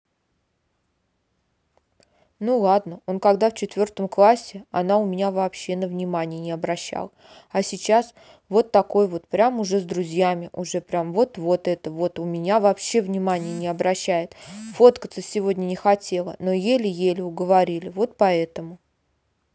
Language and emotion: Russian, neutral